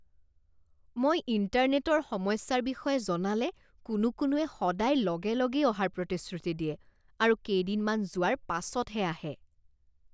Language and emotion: Assamese, disgusted